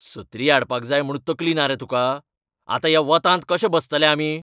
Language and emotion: Goan Konkani, angry